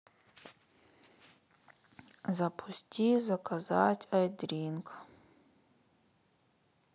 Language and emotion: Russian, sad